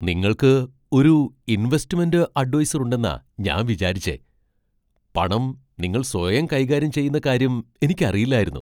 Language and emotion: Malayalam, surprised